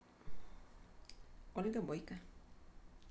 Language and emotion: Russian, neutral